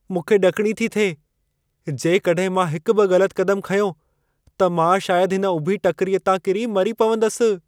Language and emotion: Sindhi, fearful